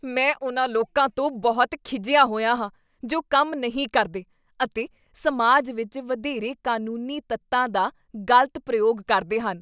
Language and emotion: Punjabi, disgusted